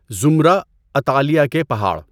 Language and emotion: Urdu, neutral